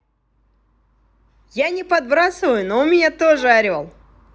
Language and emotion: Russian, positive